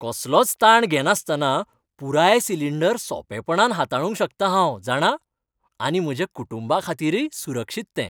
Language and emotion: Goan Konkani, happy